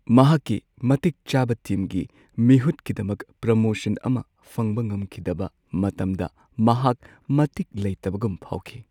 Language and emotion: Manipuri, sad